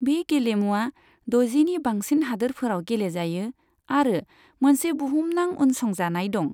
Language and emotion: Bodo, neutral